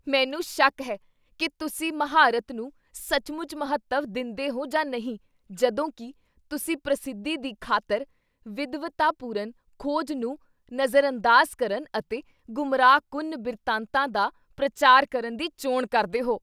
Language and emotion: Punjabi, disgusted